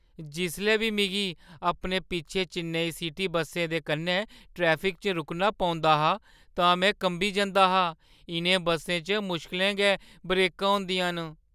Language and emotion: Dogri, fearful